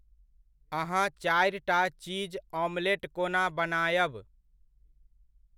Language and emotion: Maithili, neutral